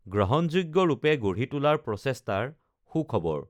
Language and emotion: Assamese, neutral